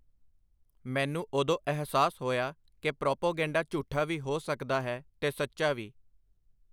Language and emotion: Punjabi, neutral